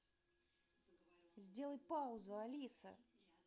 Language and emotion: Russian, angry